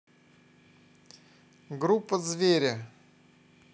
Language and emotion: Russian, neutral